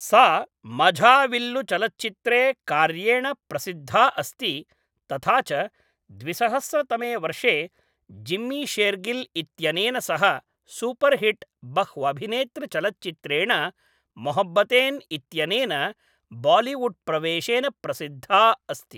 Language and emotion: Sanskrit, neutral